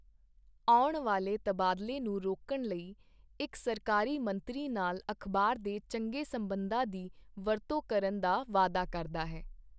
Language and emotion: Punjabi, neutral